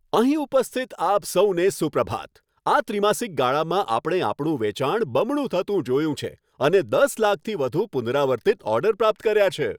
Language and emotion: Gujarati, happy